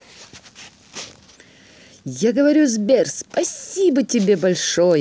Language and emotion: Russian, positive